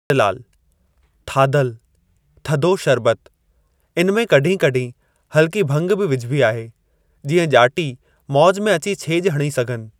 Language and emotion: Sindhi, neutral